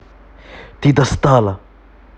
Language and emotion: Russian, angry